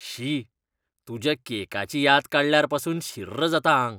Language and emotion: Goan Konkani, disgusted